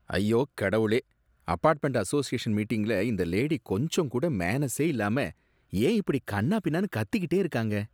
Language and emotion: Tamil, disgusted